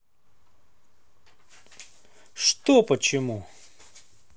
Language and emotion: Russian, neutral